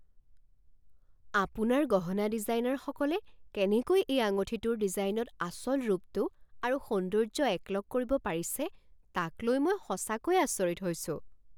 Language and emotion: Assamese, surprised